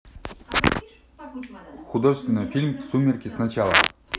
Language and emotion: Russian, neutral